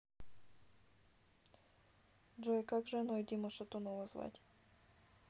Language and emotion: Russian, neutral